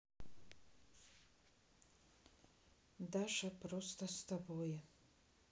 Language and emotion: Russian, sad